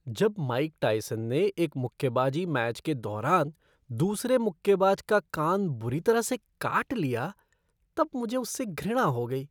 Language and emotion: Hindi, disgusted